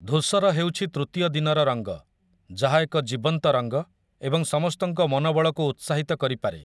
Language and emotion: Odia, neutral